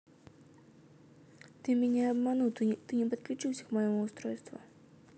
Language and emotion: Russian, neutral